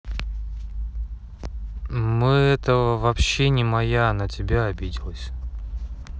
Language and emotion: Russian, neutral